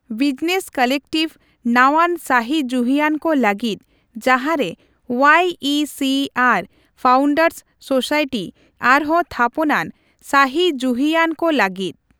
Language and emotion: Santali, neutral